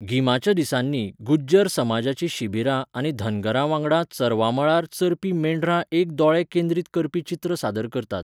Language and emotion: Goan Konkani, neutral